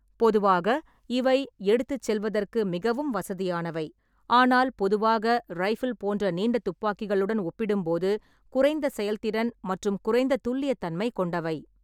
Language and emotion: Tamil, neutral